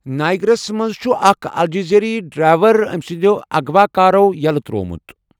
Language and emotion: Kashmiri, neutral